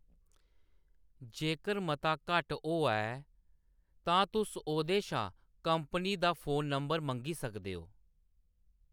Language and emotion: Dogri, neutral